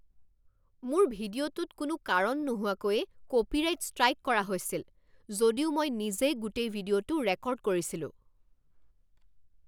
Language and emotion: Assamese, angry